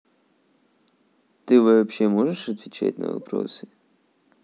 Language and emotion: Russian, neutral